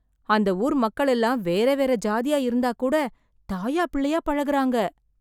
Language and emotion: Tamil, surprised